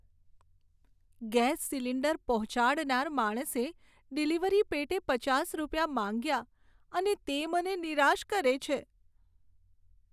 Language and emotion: Gujarati, sad